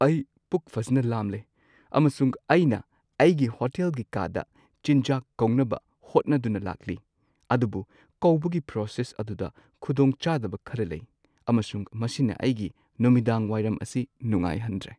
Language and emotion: Manipuri, sad